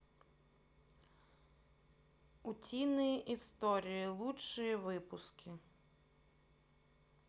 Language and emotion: Russian, neutral